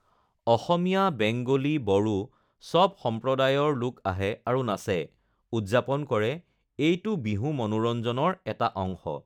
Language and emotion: Assamese, neutral